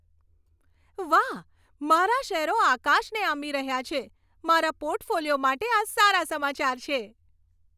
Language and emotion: Gujarati, happy